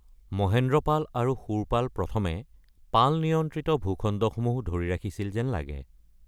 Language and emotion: Assamese, neutral